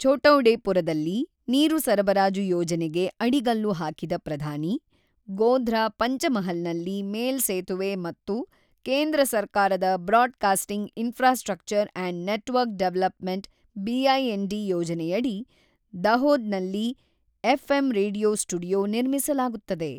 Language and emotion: Kannada, neutral